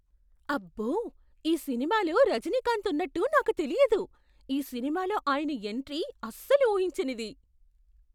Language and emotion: Telugu, surprised